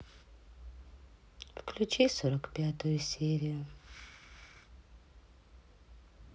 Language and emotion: Russian, sad